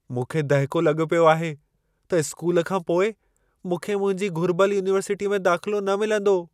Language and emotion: Sindhi, fearful